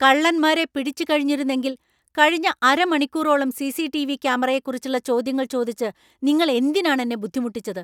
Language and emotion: Malayalam, angry